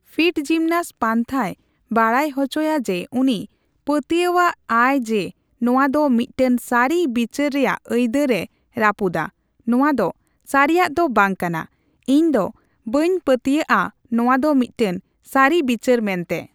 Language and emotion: Santali, neutral